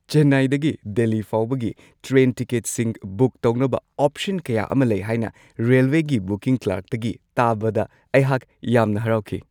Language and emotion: Manipuri, happy